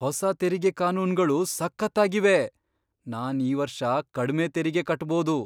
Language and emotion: Kannada, surprised